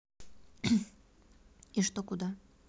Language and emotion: Russian, neutral